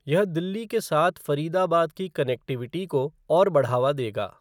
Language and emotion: Hindi, neutral